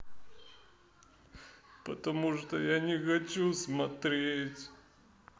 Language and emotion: Russian, sad